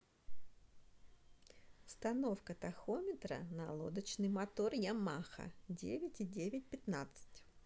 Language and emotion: Russian, neutral